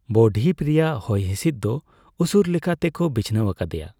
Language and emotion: Santali, neutral